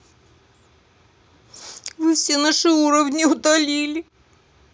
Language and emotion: Russian, sad